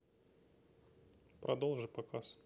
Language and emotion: Russian, neutral